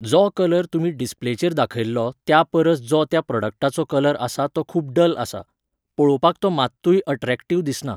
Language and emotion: Goan Konkani, neutral